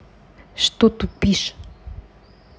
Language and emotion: Russian, angry